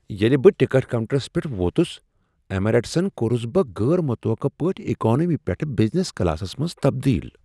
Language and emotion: Kashmiri, surprised